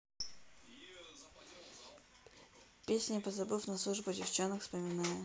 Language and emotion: Russian, neutral